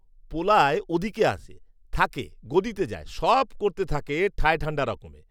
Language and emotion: Bengali, neutral